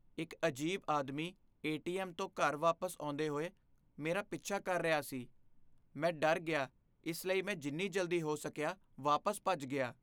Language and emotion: Punjabi, fearful